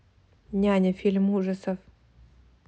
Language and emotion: Russian, neutral